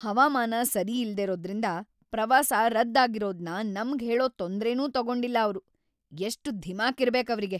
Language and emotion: Kannada, angry